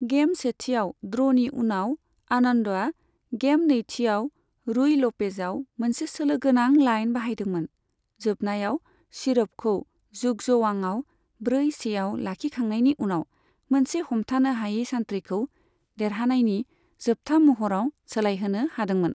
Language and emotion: Bodo, neutral